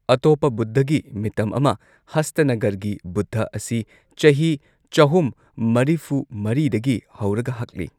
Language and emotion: Manipuri, neutral